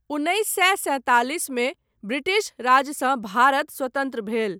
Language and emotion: Maithili, neutral